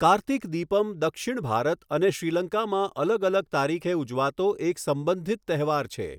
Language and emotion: Gujarati, neutral